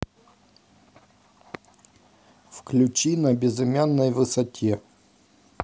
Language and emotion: Russian, neutral